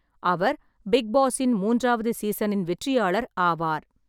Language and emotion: Tamil, neutral